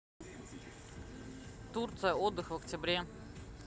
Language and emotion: Russian, neutral